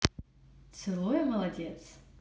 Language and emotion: Russian, neutral